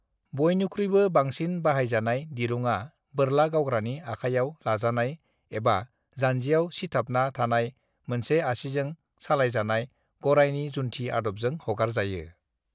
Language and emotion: Bodo, neutral